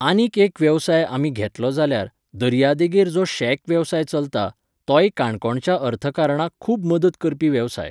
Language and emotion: Goan Konkani, neutral